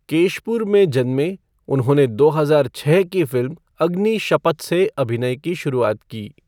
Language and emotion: Hindi, neutral